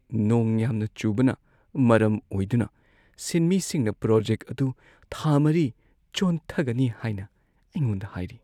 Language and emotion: Manipuri, sad